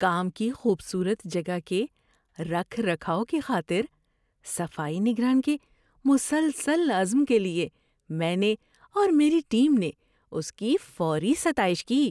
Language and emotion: Urdu, happy